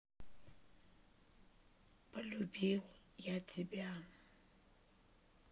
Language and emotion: Russian, sad